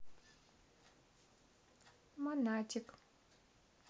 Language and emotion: Russian, neutral